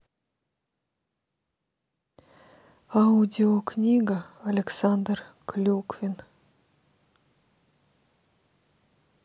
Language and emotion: Russian, neutral